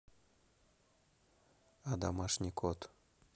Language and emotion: Russian, neutral